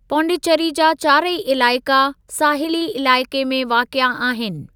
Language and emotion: Sindhi, neutral